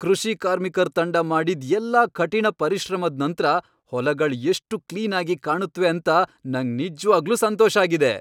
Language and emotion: Kannada, happy